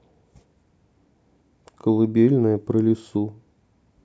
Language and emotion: Russian, neutral